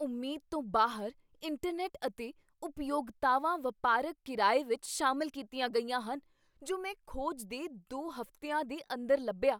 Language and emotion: Punjabi, surprised